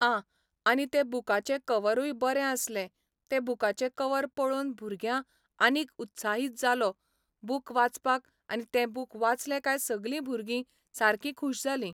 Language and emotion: Goan Konkani, neutral